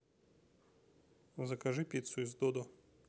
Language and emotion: Russian, neutral